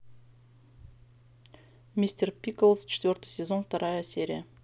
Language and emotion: Russian, neutral